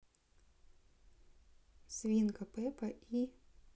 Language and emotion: Russian, neutral